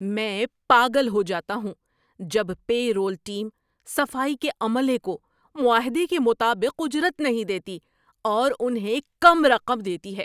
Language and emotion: Urdu, angry